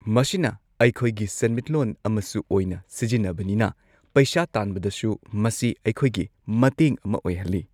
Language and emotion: Manipuri, neutral